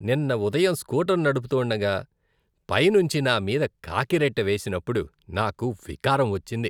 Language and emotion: Telugu, disgusted